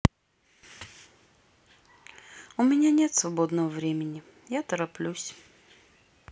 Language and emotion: Russian, sad